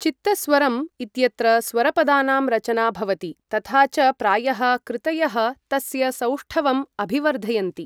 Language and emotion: Sanskrit, neutral